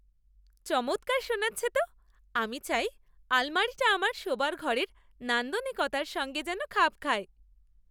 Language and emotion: Bengali, happy